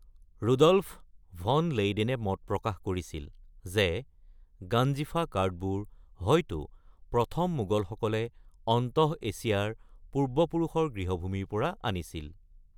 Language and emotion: Assamese, neutral